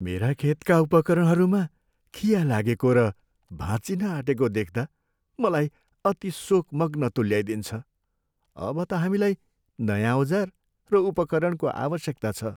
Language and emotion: Nepali, sad